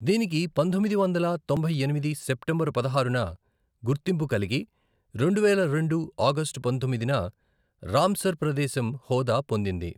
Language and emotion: Telugu, neutral